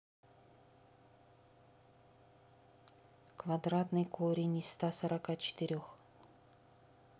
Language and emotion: Russian, neutral